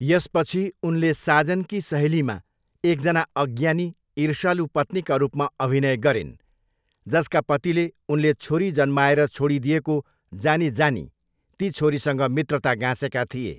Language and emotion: Nepali, neutral